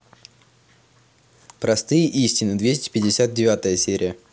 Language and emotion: Russian, neutral